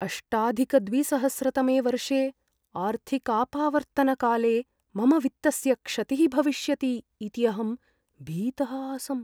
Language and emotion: Sanskrit, fearful